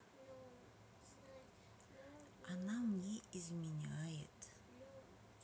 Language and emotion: Russian, sad